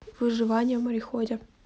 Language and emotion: Russian, neutral